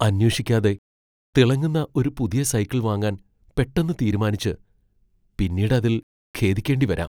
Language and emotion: Malayalam, fearful